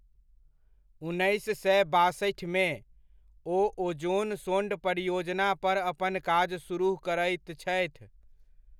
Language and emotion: Maithili, neutral